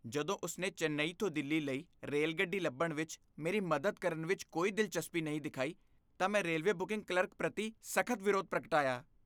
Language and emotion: Punjabi, disgusted